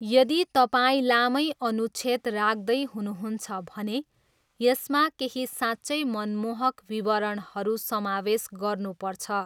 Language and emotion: Nepali, neutral